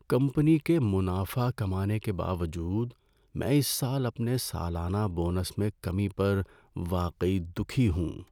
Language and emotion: Urdu, sad